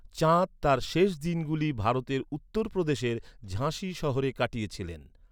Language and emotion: Bengali, neutral